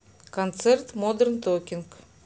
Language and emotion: Russian, neutral